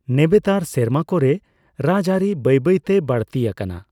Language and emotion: Santali, neutral